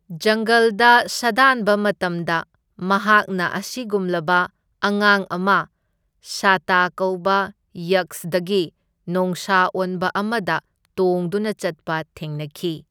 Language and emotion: Manipuri, neutral